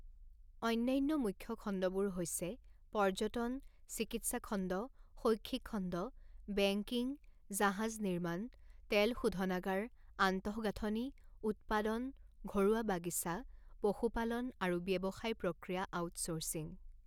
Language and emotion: Assamese, neutral